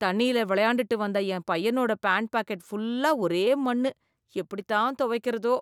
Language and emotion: Tamil, disgusted